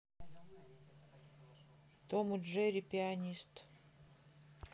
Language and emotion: Russian, neutral